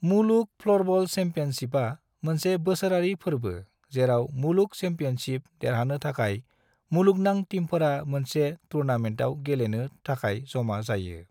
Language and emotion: Bodo, neutral